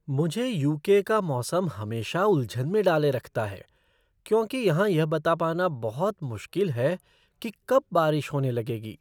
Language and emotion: Hindi, surprised